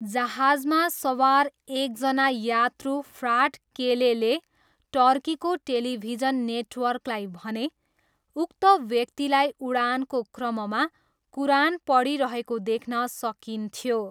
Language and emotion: Nepali, neutral